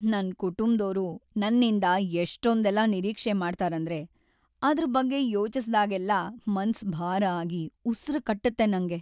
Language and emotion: Kannada, sad